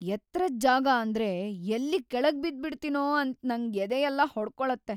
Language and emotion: Kannada, fearful